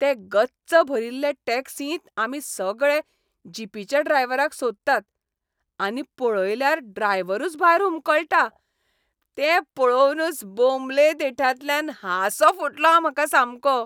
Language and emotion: Goan Konkani, happy